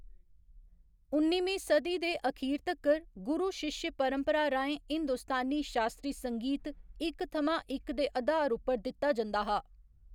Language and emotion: Dogri, neutral